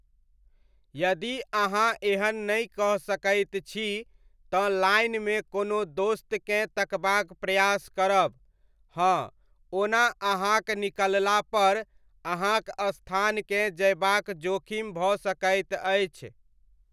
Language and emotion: Maithili, neutral